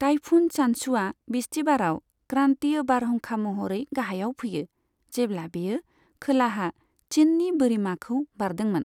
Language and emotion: Bodo, neutral